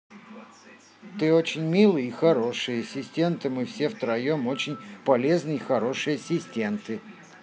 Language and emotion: Russian, positive